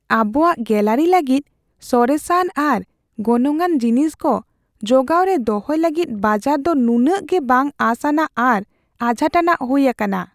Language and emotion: Santali, fearful